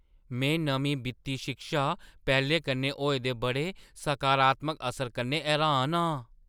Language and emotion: Dogri, surprised